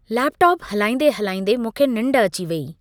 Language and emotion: Sindhi, neutral